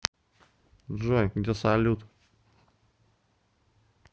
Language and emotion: Russian, neutral